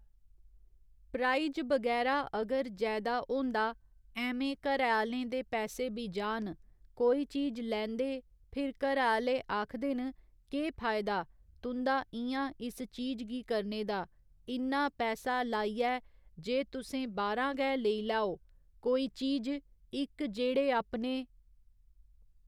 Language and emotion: Dogri, neutral